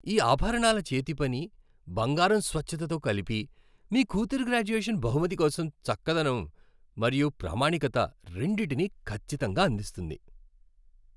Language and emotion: Telugu, happy